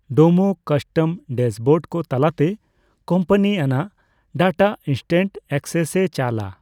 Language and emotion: Santali, neutral